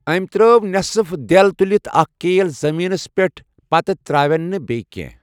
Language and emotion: Kashmiri, neutral